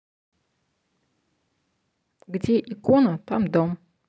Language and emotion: Russian, neutral